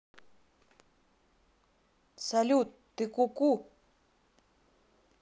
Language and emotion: Russian, neutral